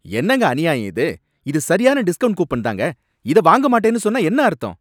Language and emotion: Tamil, angry